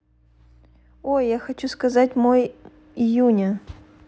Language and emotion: Russian, neutral